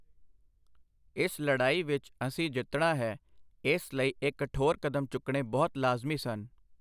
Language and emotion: Punjabi, neutral